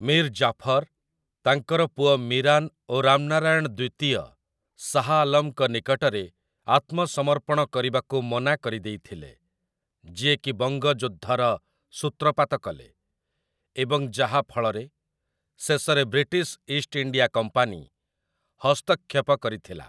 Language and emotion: Odia, neutral